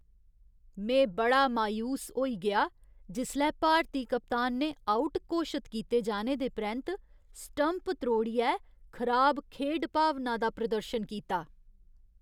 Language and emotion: Dogri, disgusted